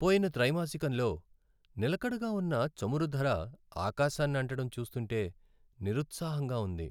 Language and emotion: Telugu, sad